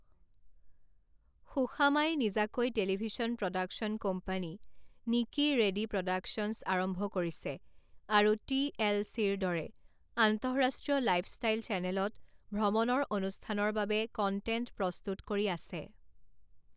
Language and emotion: Assamese, neutral